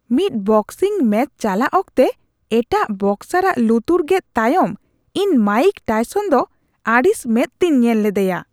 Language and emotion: Santali, disgusted